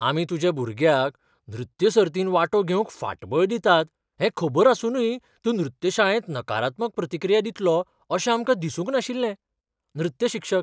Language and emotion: Goan Konkani, surprised